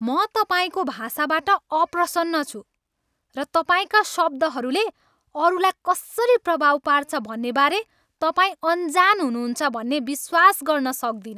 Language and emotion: Nepali, angry